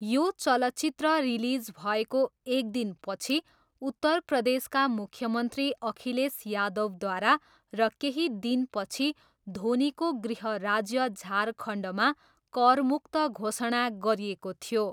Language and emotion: Nepali, neutral